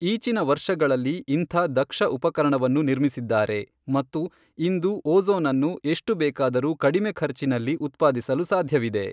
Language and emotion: Kannada, neutral